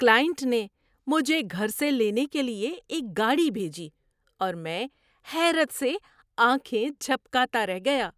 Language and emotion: Urdu, surprised